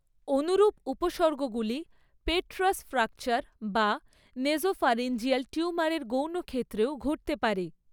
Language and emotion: Bengali, neutral